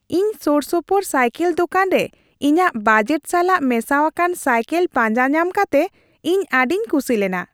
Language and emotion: Santali, happy